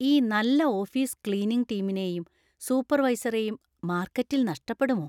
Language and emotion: Malayalam, fearful